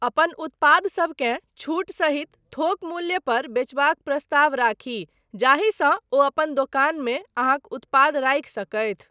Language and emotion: Maithili, neutral